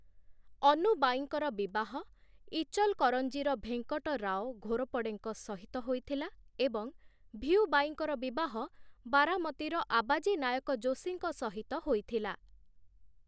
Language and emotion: Odia, neutral